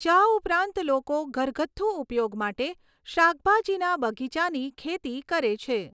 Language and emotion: Gujarati, neutral